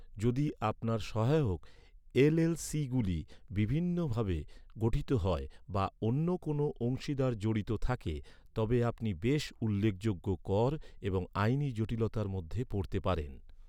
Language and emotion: Bengali, neutral